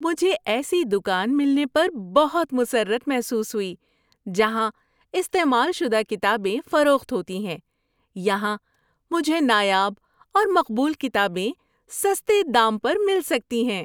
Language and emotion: Urdu, happy